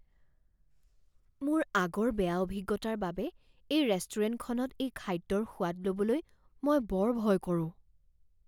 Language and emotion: Assamese, fearful